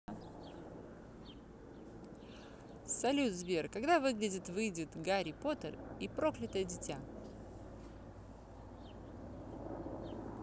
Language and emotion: Russian, positive